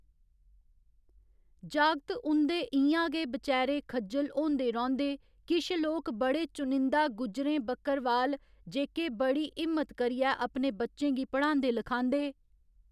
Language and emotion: Dogri, neutral